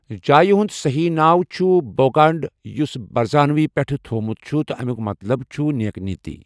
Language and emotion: Kashmiri, neutral